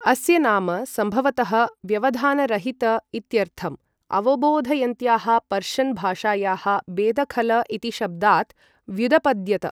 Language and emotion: Sanskrit, neutral